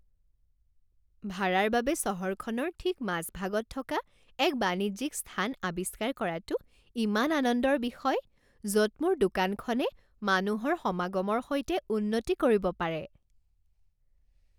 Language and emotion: Assamese, happy